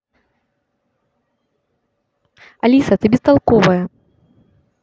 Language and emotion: Russian, angry